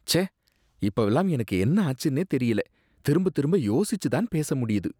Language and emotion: Tamil, disgusted